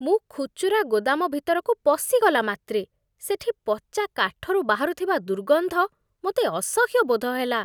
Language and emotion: Odia, disgusted